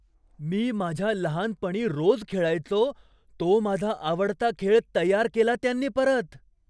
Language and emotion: Marathi, surprised